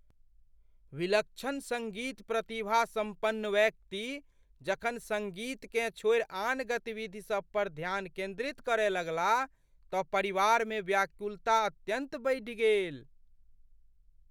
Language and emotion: Maithili, fearful